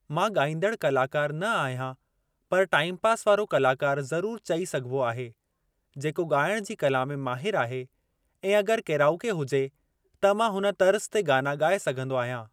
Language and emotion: Sindhi, neutral